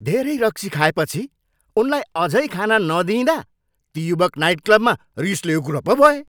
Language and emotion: Nepali, angry